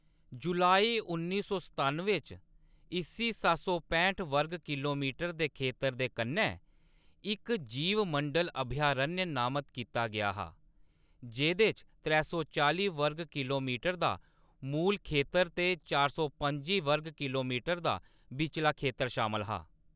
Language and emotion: Dogri, neutral